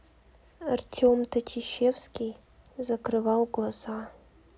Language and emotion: Russian, sad